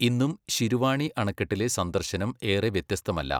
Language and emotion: Malayalam, neutral